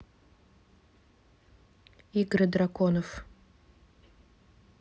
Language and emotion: Russian, neutral